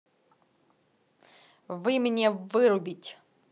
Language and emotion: Russian, angry